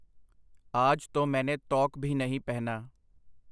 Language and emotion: Punjabi, neutral